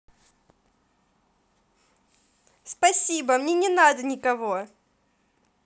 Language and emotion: Russian, positive